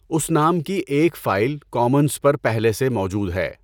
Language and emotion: Urdu, neutral